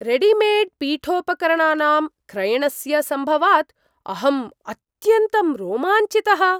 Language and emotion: Sanskrit, surprised